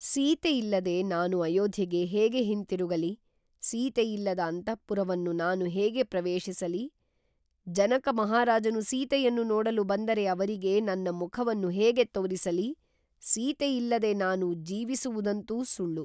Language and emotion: Kannada, neutral